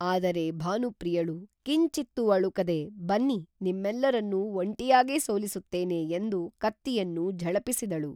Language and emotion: Kannada, neutral